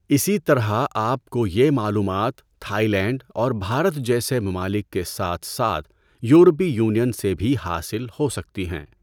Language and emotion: Urdu, neutral